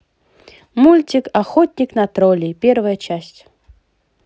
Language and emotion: Russian, positive